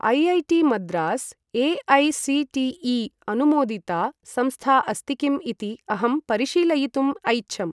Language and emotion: Sanskrit, neutral